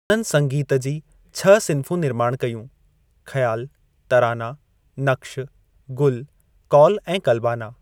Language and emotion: Sindhi, neutral